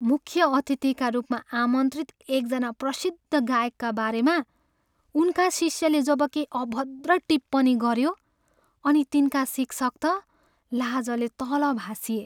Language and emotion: Nepali, sad